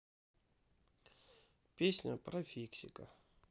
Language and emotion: Russian, sad